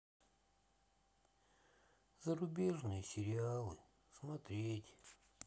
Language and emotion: Russian, sad